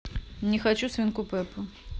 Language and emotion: Russian, neutral